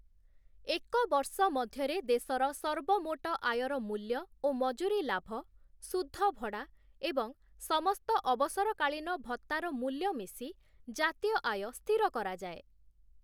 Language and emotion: Odia, neutral